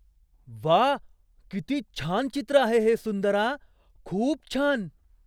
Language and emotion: Marathi, surprised